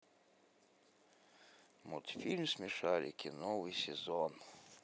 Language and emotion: Russian, sad